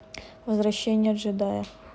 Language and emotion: Russian, neutral